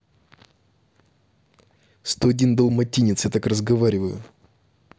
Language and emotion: Russian, angry